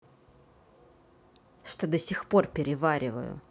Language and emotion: Russian, angry